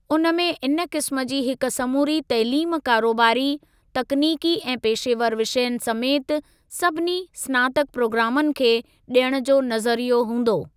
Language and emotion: Sindhi, neutral